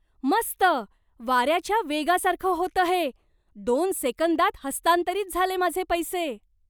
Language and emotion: Marathi, surprised